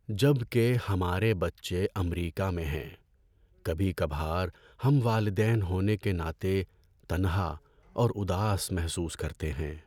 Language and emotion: Urdu, sad